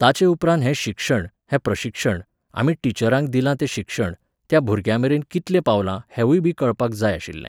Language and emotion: Goan Konkani, neutral